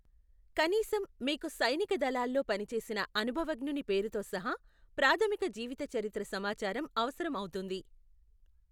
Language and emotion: Telugu, neutral